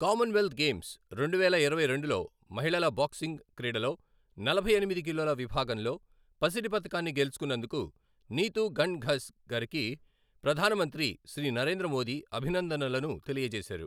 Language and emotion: Telugu, neutral